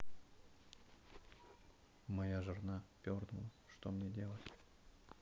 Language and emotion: Russian, neutral